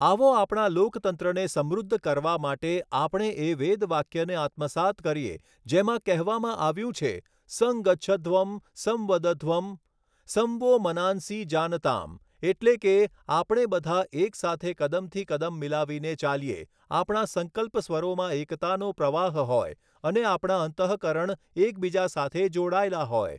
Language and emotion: Gujarati, neutral